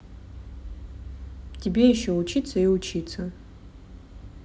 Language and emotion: Russian, neutral